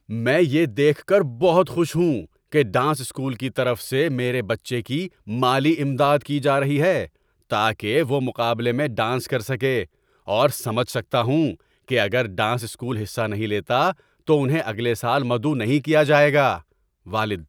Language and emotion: Urdu, happy